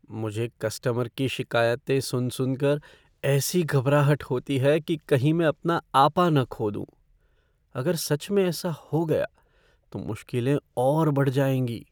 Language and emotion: Hindi, fearful